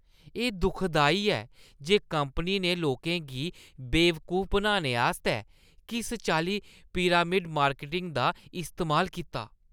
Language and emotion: Dogri, disgusted